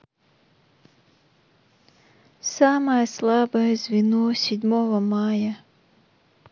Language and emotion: Russian, sad